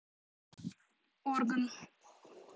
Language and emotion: Russian, neutral